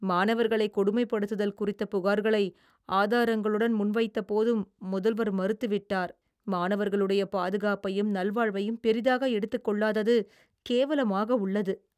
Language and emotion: Tamil, disgusted